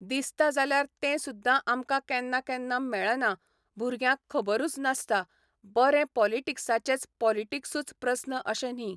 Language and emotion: Goan Konkani, neutral